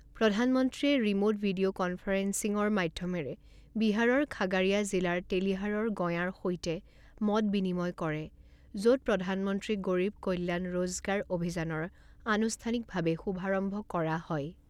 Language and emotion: Assamese, neutral